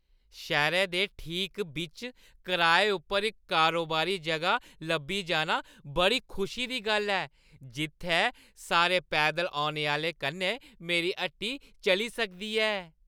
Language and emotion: Dogri, happy